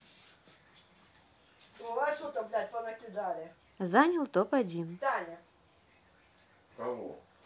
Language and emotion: Russian, neutral